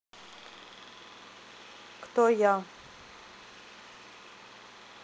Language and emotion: Russian, neutral